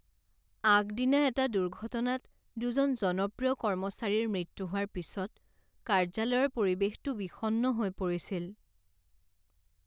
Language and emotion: Assamese, sad